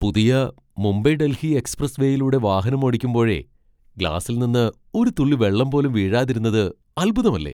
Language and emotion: Malayalam, surprised